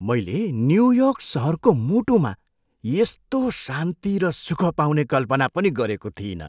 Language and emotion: Nepali, surprised